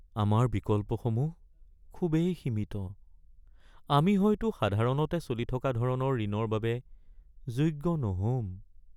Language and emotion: Assamese, sad